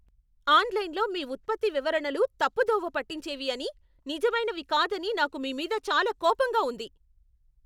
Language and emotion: Telugu, angry